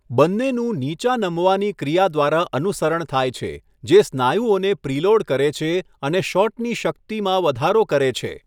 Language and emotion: Gujarati, neutral